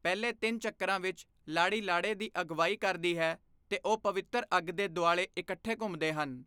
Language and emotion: Punjabi, neutral